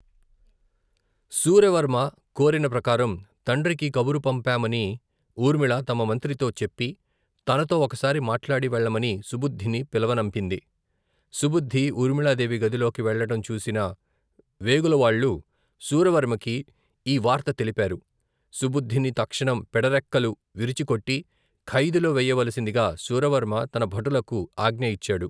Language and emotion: Telugu, neutral